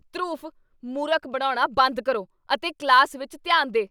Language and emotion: Punjabi, angry